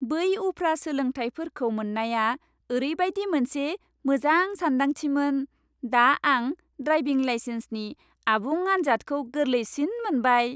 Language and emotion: Bodo, happy